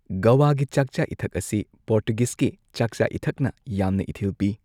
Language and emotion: Manipuri, neutral